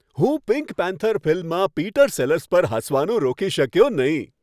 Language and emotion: Gujarati, happy